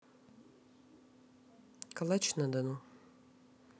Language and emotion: Russian, neutral